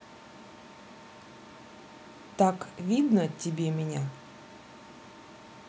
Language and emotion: Russian, neutral